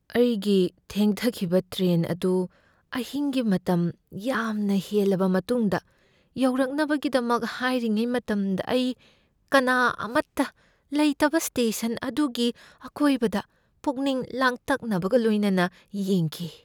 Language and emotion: Manipuri, fearful